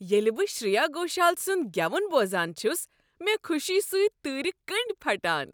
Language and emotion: Kashmiri, happy